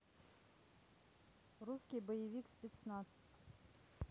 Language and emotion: Russian, neutral